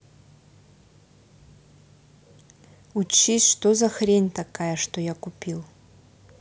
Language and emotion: Russian, angry